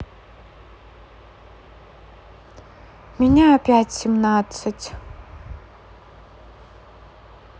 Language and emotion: Russian, sad